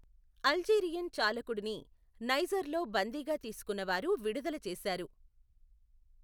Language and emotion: Telugu, neutral